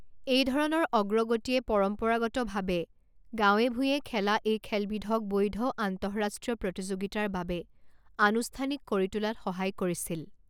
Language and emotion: Assamese, neutral